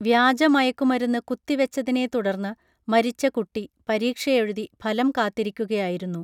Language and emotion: Malayalam, neutral